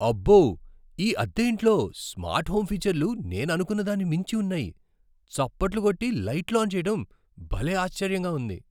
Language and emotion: Telugu, surprised